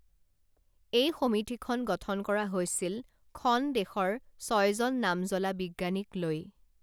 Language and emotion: Assamese, neutral